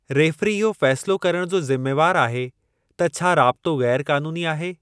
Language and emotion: Sindhi, neutral